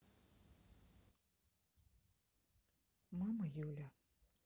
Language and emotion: Russian, sad